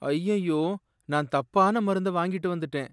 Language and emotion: Tamil, sad